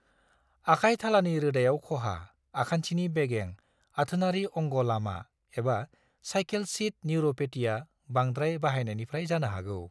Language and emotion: Bodo, neutral